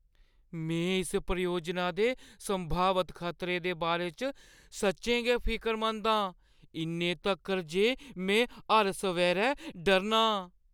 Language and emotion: Dogri, fearful